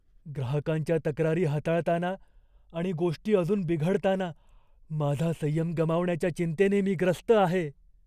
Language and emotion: Marathi, fearful